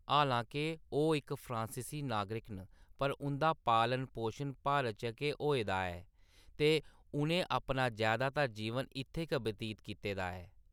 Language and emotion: Dogri, neutral